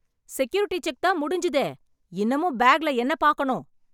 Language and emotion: Tamil, angry